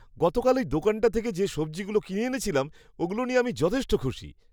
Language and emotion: Bengali, happy